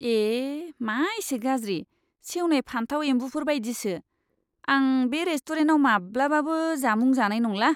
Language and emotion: Bodo, disgusted